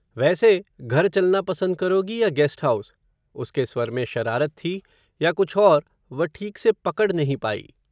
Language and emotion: Hindi, neutral